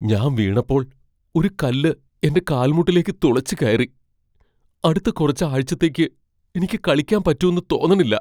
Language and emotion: Malayalam, fearful